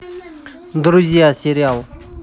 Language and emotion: Russian, neutral